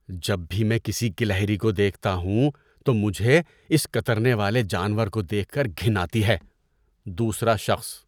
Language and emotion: Urdu, disgusted